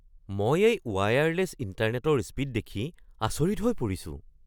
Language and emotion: Assamese, surprised